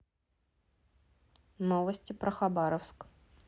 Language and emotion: Russian, neutral